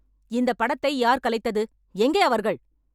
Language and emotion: Tamil, angry